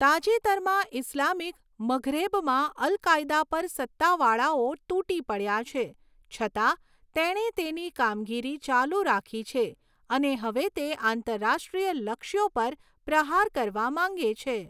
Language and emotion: Gujarati, neutral